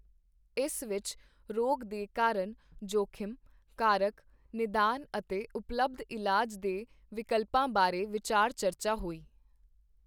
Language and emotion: Punjabi, neutral